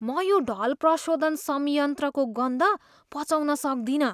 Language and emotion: Nepali, disgusted